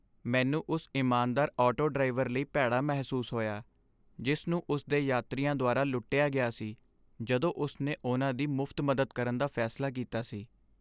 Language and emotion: Punjabi, sad